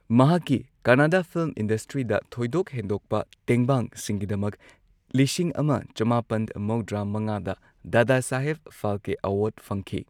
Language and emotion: Manipuri, neutral